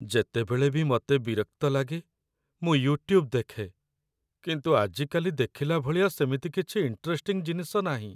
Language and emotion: Odia, sad